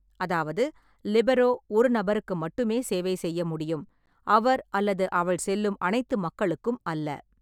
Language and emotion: Tamil, neutral